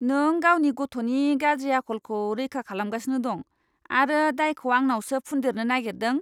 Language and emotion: Bodo, disgusted